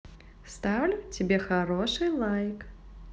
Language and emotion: Russian, positive